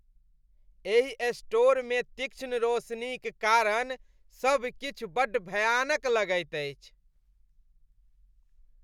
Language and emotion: Maithili, disgusted